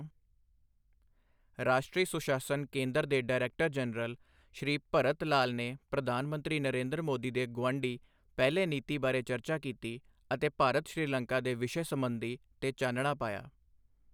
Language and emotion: Punjabi, neutral